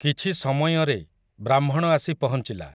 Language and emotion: Odia, neutral